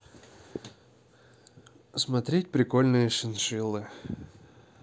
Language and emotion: Russian, neutral